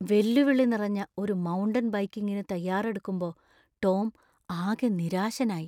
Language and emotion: Malayalam, fearful